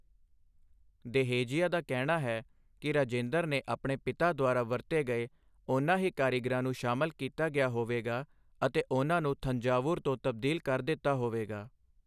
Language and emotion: Punjabi, neutral